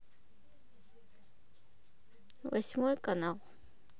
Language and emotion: Russian, neutral